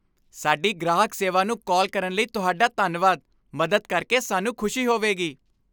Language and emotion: Punjabi, happy